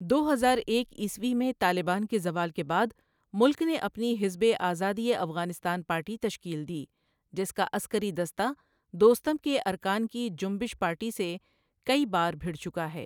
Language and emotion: Urdu, neutral